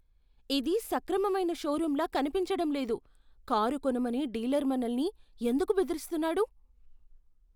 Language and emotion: Telugu, fearful